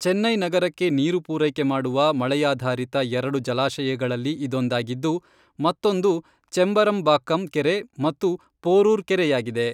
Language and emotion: Kannada, neutral